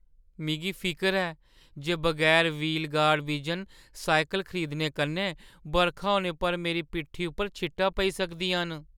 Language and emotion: Dogri, fearful